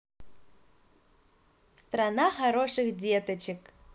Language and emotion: Russian, positive